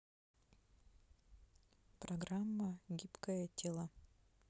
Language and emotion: Russian, neutral